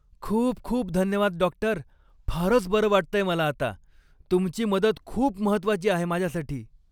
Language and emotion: Marathi, happy